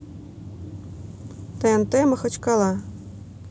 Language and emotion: Russian, neutral